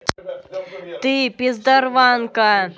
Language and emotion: Russian, angry